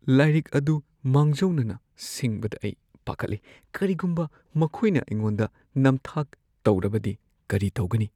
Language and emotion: Manipuri, fearful